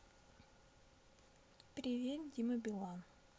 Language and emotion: Russian, neutral